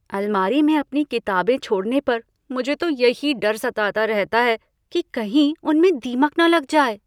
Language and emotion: Hindi, fearful